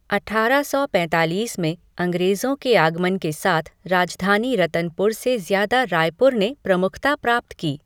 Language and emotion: Hindi, neutral